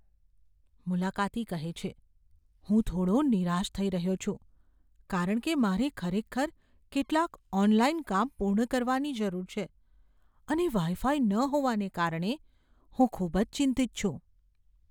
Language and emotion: Gujarati, fearful